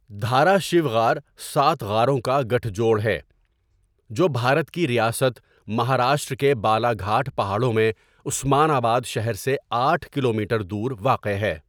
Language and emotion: Urdu, neutral